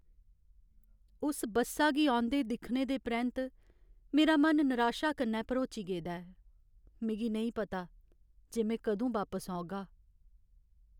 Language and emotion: Dogri, sad